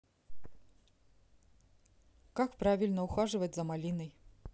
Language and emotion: Russian, neutral